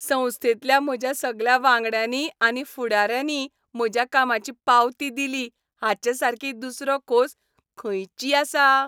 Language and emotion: Goan Konkani, happy